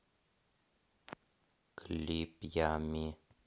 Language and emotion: Russian, neutral